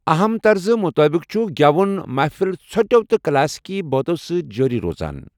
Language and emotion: Kashmiri, neutral